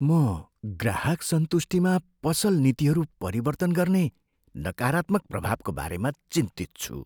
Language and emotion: Nepali, fearful